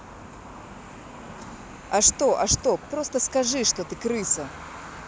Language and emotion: Russian, angry